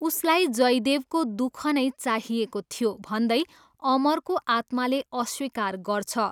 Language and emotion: Nepali, neutral